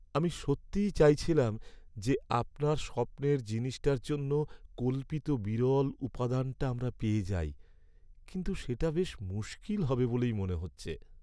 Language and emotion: Bengali, sad